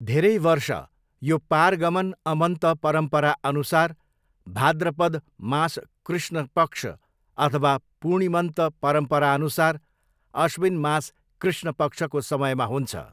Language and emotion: Nepali, neutral